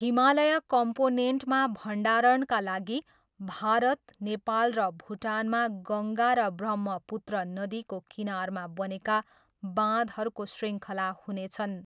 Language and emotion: Nepali, neutral